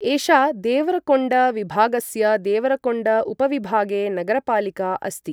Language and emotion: Sanskrit, neutral